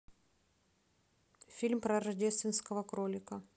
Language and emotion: Russian, neutral